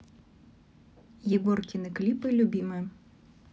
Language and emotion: Russian, neutral